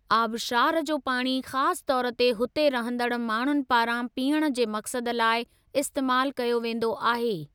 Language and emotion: Sindhi, neutral